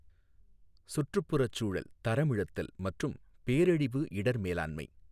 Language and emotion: Tamil, neutral